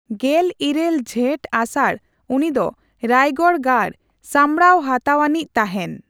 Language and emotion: Santali, neutral